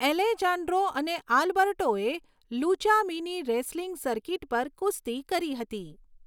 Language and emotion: Gujarati, neutral